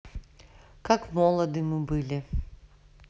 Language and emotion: Russian, neutral